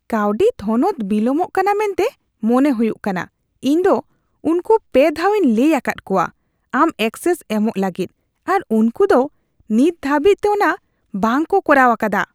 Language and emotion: Santali, disgusted